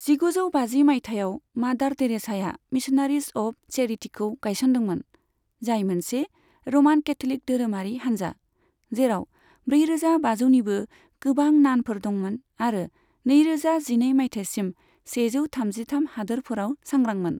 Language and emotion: Bodo, neutral